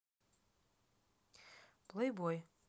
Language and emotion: Russian, neutral